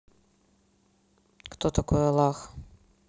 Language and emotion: Russian, neutral